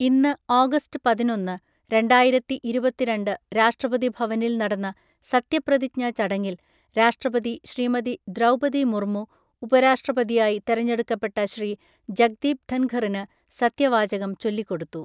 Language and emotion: Malayalam, neutral